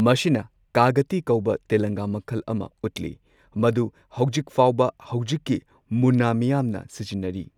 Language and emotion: Manipuri, neutral